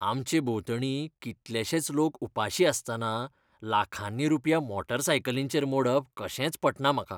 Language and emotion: Goan Konkani, disgusted